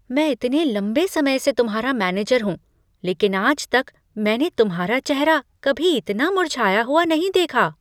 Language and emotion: Hindi, surprised